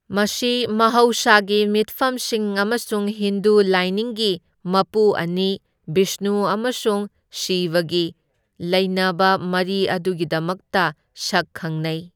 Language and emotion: Manipuri, neutral